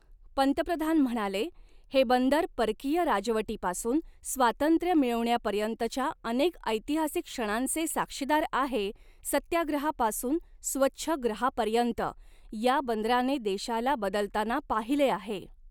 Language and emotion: Marathi, neutral